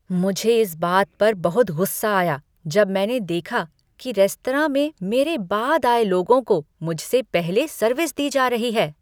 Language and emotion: Hindi, angry